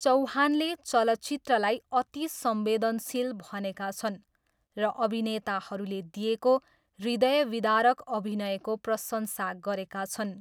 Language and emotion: Nepali, neutral